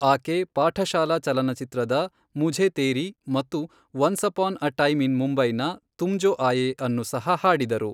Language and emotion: Kannada, neutral